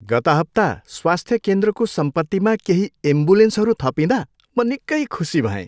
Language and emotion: Nepali, happy